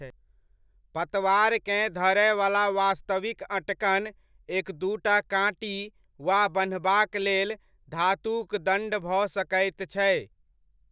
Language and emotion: Maithili, neutral